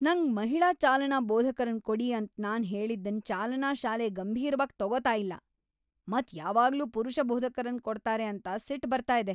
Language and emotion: Kannada, angry